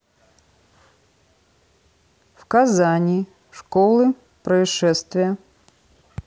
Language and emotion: Russian, neutral